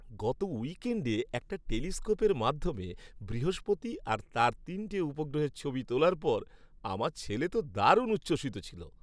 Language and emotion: Bengali, happy